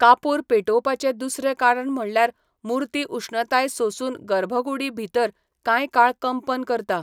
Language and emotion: Goan Konkani, neutral